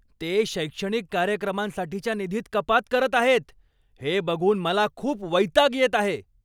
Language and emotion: Marathi, angry